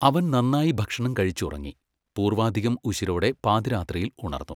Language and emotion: Malayalam, neutral